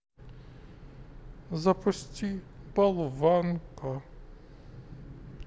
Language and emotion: Russian, sad